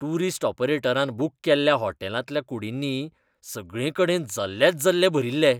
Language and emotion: Goan Konkani, disgusted